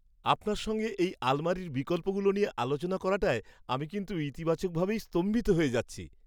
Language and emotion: Bengali, surprised